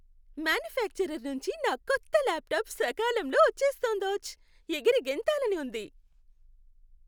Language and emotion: Telugu, happy